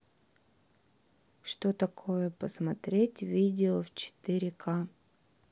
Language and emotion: Russian, neutral